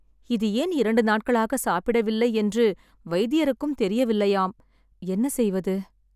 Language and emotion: Tamil, sad